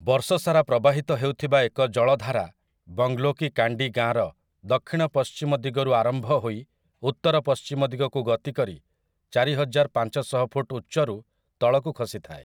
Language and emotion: Odia, neutral